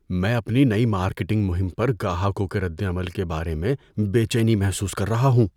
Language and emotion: Urdu, fearful